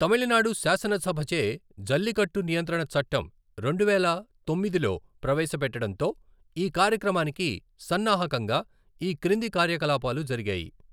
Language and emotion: Telugu, neutral